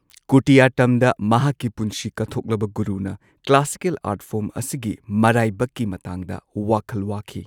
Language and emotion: Manipuri, neutral